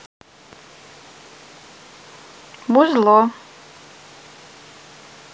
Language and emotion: Russian, neutral